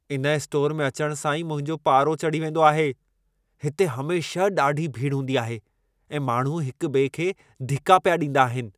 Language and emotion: Sindhi, angry